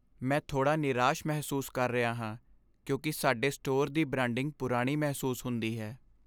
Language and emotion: Punjabi, sad